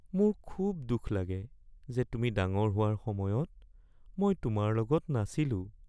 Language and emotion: Assamese, sad